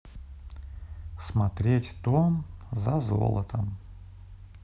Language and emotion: Russian, neutral